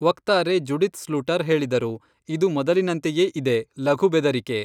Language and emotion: Kannada, neutral